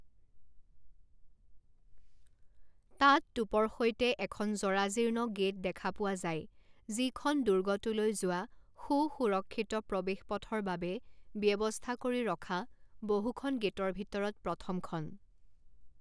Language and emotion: Assamese, neutral